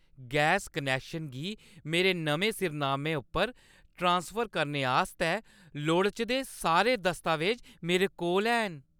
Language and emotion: Dogri, happy